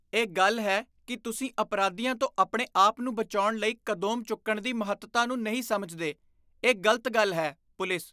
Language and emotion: Punjabi, disgusted